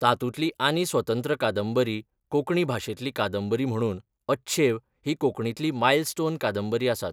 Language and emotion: Goan Konkani, neutral